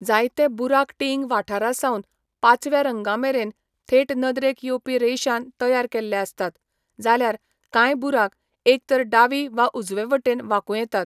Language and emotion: Goan Konkani, neutral